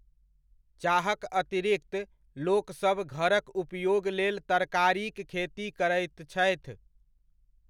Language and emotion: Maithili, neutral